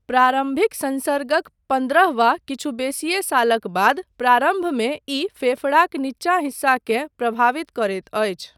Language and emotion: Maithili, neutral